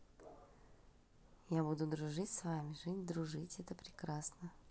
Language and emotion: Russian, positive